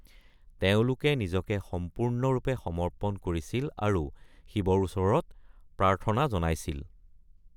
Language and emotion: Assamese, neutral